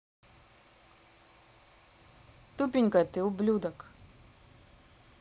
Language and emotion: Russian, neutral